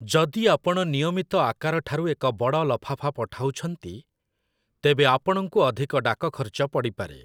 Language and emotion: Odia, neutral